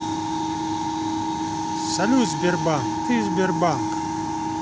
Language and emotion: Russian, positive